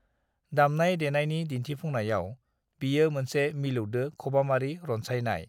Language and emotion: Bodo, neutral